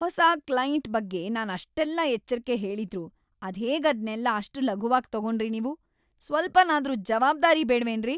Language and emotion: Kannada, angry